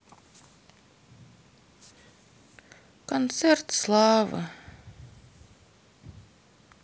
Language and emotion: Russian, sad